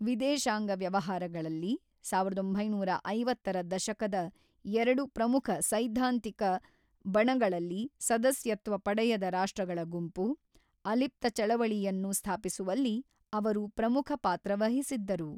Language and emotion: Kannada, neutral